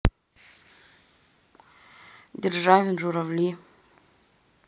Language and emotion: Russian, neutral